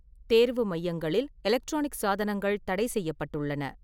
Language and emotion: Tamil, neutral